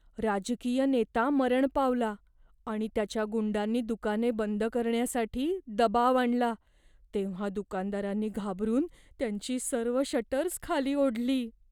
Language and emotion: Marathi, fearful